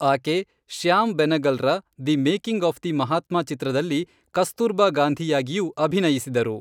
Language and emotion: Kannada, neutral